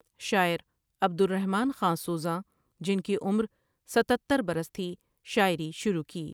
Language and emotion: Urdu, neutral